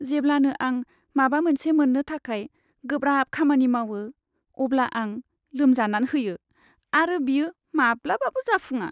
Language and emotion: Bodo, sad